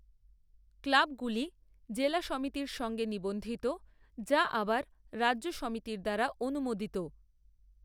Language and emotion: Bengali, neutral